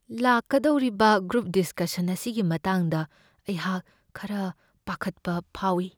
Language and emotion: Manipuri, fearful